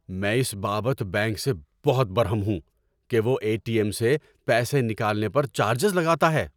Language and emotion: Urdu, angry